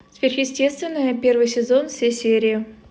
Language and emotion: Russian, neutral